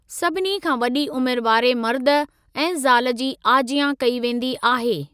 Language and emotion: Sindhi, neutral